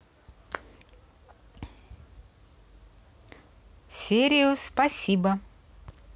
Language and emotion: Russian, positive